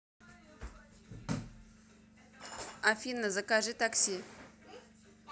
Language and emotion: Russian, neutral